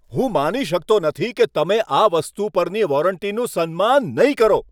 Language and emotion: Gujarati, angry